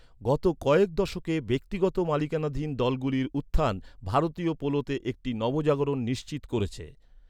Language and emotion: Bengali, neutral